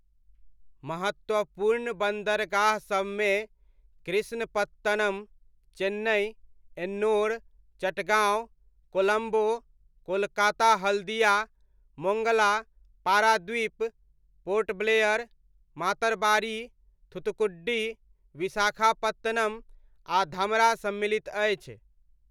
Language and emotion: Maithili, neutral